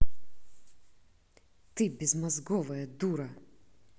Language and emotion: Russian, angry